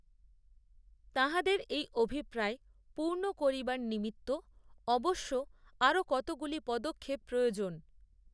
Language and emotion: Bengali, neutral